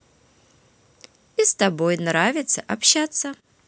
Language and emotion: Russian, positive